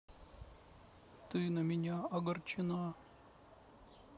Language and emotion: Russian, sad